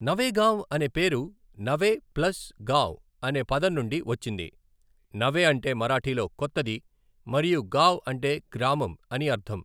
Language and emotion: Telugu, neutral